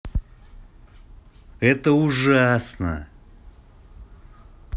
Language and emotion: Russian, angry